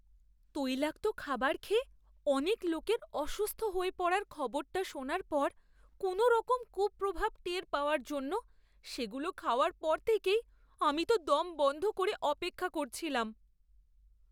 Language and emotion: Bengali, fearful